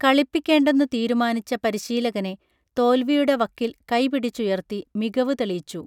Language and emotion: Malayalam, neutral